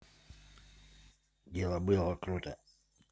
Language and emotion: Russian, neutral